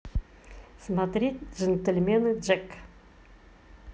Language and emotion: Russian, positive